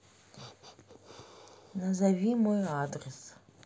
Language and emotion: Russian, neutral